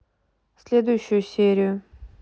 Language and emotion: Russian, neutral